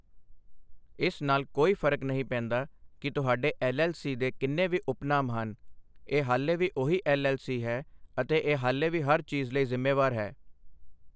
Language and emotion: Punjabi, neutral